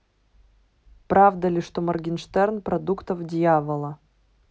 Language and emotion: Russian, neutral